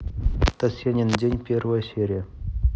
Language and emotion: Russian, neutral